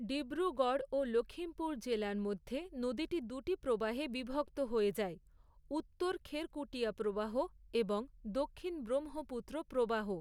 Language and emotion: Bengali, neutral